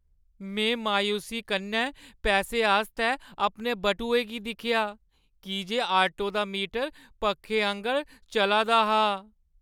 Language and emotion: Dogri, sad